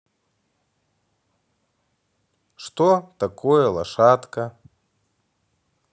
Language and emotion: Russian, neutral